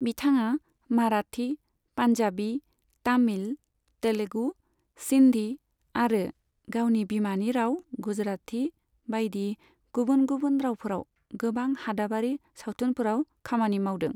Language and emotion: Bodo, neutral